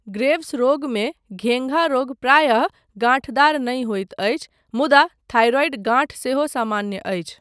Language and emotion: Maithili, neutral